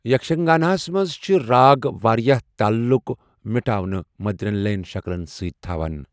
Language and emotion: Kashmiri, neutral